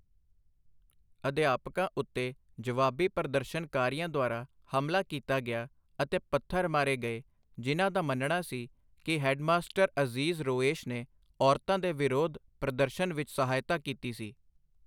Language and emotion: Punjabi, neutral